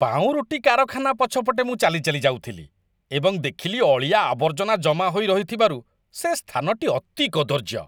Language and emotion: Odia, disgusted